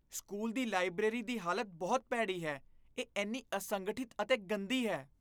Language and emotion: Punjabi, disgusted